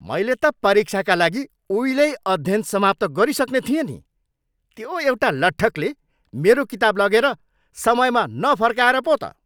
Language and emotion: Nepali, angry